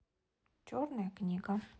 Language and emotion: Russian, neutral